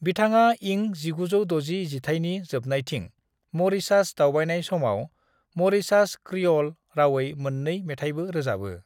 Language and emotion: Bodo, neutral